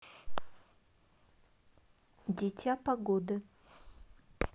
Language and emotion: Russian, neutral